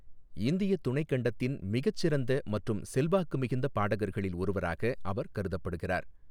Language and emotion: Tamil, neutral